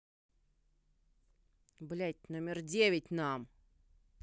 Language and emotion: Russian, angry